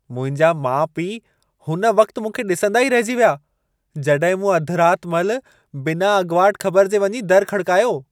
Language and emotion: Sindhi, surprised